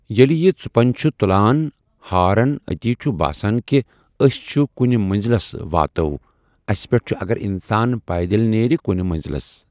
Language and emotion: Kashmiri, neutral